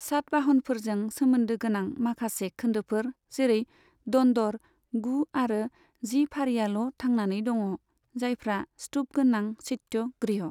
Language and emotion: Bodo, neutral